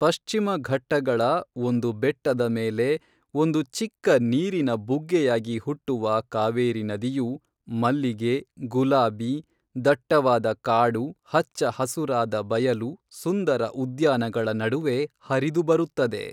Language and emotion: Kannada, neutral